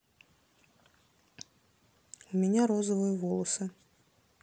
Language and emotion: Russian, neutral